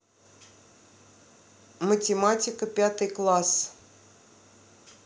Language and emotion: Russian, neutral